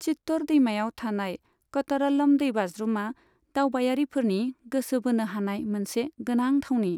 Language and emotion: Bodo, neutral